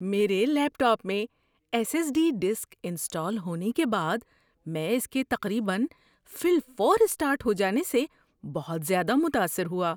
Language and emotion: Urdu, surprised